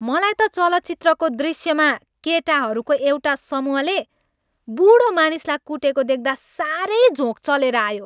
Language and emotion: Nepali, angry